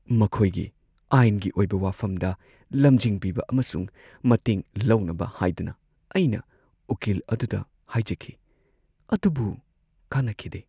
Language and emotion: Manipuri, sad